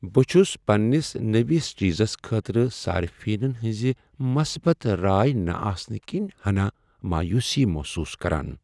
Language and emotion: Kashmiri, sad